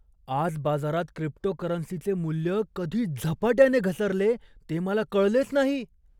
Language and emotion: Marathi, surprised